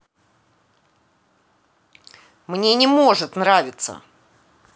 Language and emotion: Russian, angry